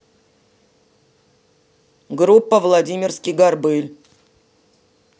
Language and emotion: Russian, neutral